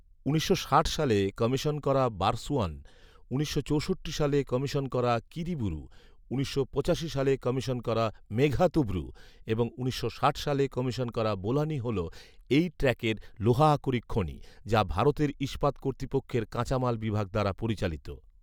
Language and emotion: Bengali, neutral